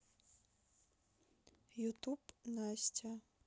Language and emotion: Russian, neutral